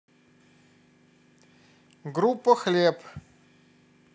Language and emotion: Russian, neutral